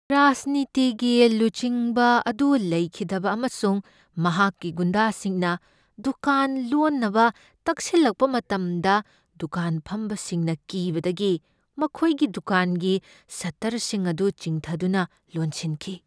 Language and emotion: Manipuri, fearful